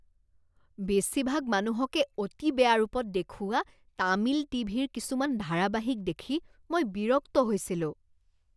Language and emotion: Assamese, disgusted